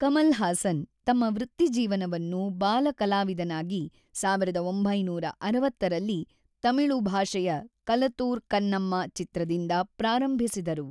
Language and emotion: Kannada, neutral